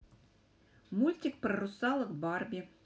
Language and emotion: Russian, positive